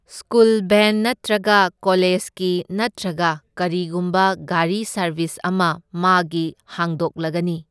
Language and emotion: Manipuri, neutral